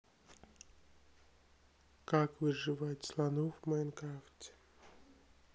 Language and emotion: Russian, sad